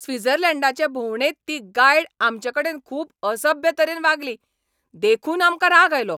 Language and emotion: Goan Konkani, angry